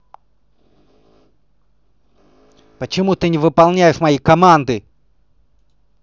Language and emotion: Russian, angry